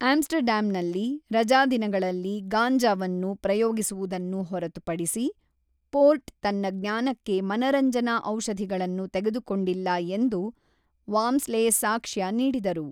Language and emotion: Kannada, neutral